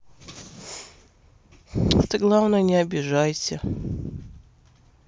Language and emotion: Russian, sad